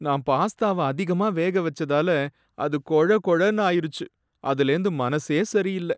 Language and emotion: Tamil, sad